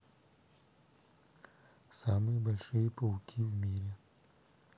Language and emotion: Russian, neutral